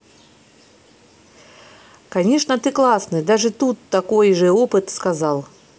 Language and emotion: Russian, positive